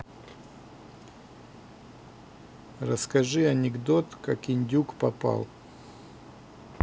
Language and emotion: Russian, neutral